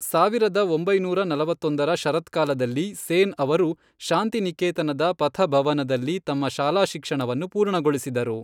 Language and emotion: Kannada, neutral